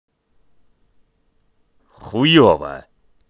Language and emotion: Russian, angry